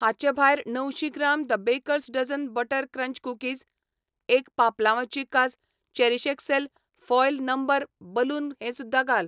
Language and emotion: Goan Konkani, neutral